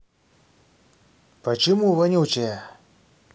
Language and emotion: Russian, angry